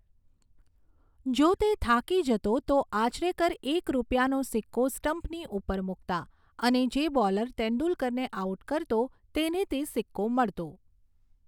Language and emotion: Gujarati, neutral